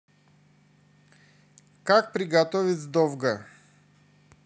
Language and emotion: Russian, neutral